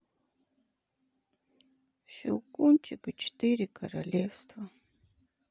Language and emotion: Russian, sad